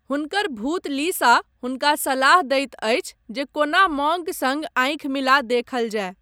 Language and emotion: Maithili, neutral